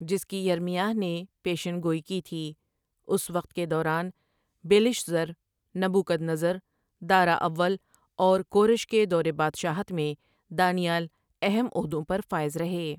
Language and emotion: Urdu, neutral